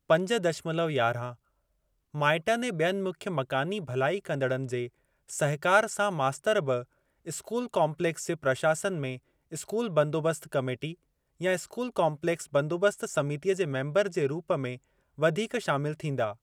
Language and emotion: Sindhi, neutral